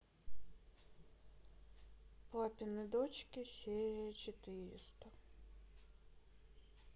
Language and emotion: Russian, sad